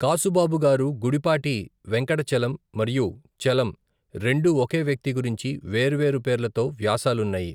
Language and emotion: Telugu, neutral